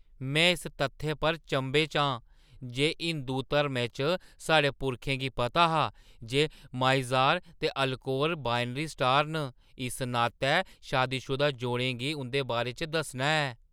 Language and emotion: Dogri, surprised